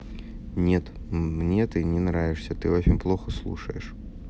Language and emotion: Russian, neutral